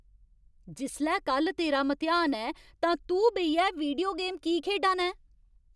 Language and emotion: Dogri, angry